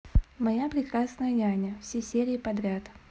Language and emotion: Russian, neutral